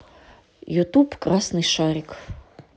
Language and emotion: Russian, neutral